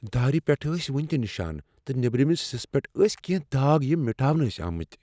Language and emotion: Kashmiri, fearful